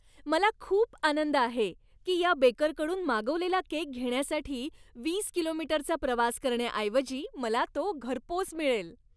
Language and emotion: Marathi, happy